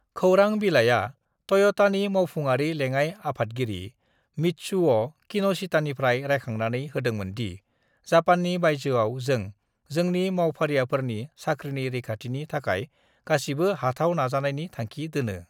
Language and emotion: Bodo, neutral